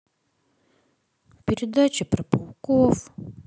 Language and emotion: Russian, sad